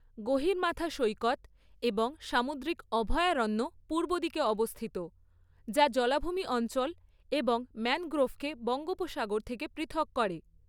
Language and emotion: Bengali, neutral